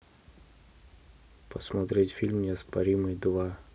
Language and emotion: Russian, neutral